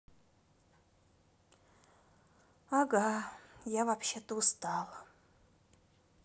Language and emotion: Russian, sad